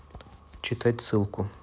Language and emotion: Russian, neutral